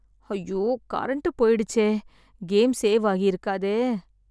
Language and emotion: Tamil, sad